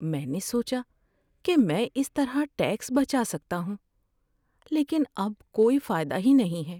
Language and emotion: Urdu, sad